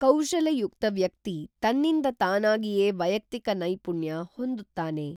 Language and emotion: Kannada, neutral